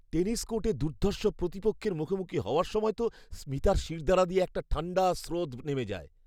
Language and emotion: Bengali, fearful